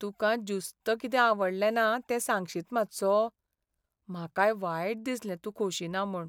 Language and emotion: Goan Konkani, sad